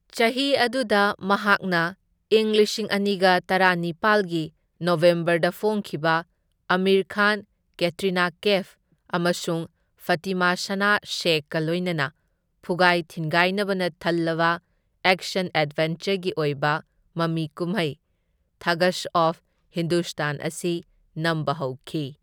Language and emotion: Manipuri, neutral